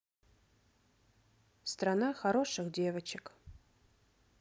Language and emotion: Russian, neutral